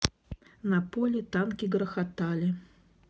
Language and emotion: Russian, neutral